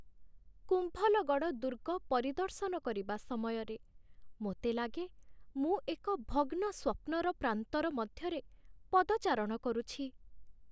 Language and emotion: Odia, sad